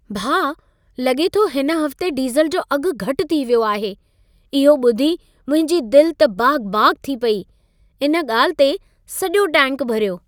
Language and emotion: Sindhi, happy